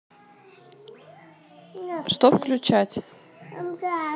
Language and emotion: Russian, neutral